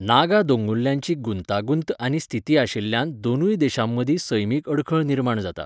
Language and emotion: Goan Konkani, neutral